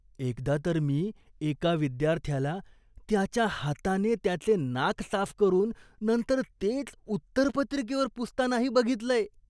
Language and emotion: Marathi, disgusted